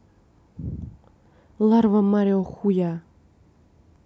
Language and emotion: Russian, neutral